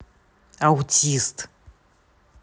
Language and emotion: Russian, neutral